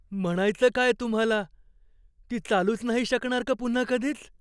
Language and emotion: Marathi, fearful